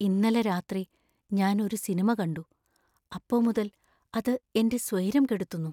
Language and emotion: Malayalam, fearful